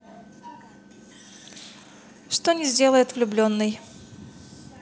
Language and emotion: Russian, positive